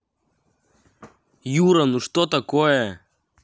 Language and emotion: Russian, angry